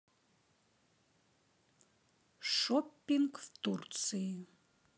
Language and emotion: Russian, neutral